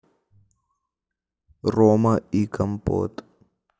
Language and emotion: Russian, neutral